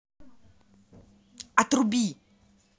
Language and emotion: Russian, angry